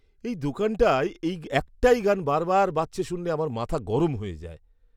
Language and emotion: Bengali, disgusted